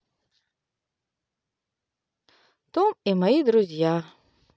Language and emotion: Russian, positive